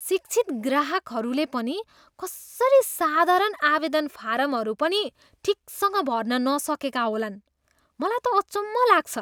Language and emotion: Nepali, disgusted